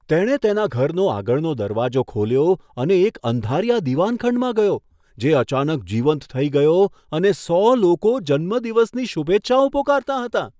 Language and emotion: Gujarati, surprised